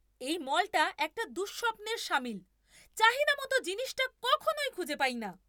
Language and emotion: Bengali, angry